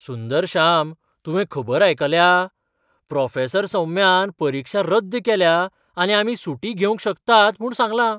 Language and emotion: Goan Konkani, surprised